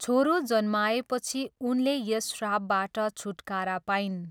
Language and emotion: Nepali, neutral